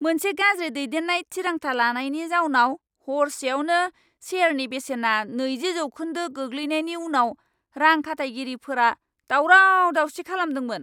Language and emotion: Bodo, angry